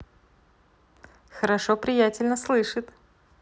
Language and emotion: Russian, positive